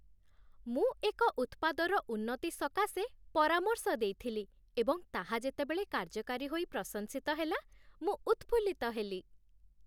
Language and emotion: Odia, happy